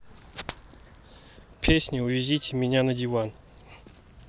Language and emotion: Russian, neutral